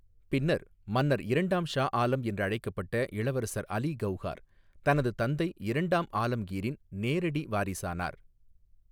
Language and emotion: Tamil, neutral